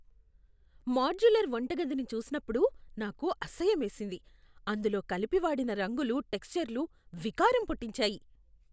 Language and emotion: Telugu, disgusted